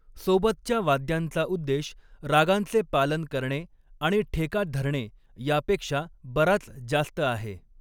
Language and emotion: Marathi, neutral